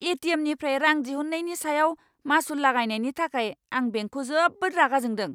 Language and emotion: Bodo, angry